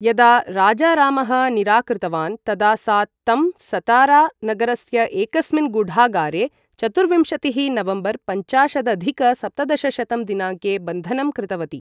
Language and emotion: Sanskrit, neutral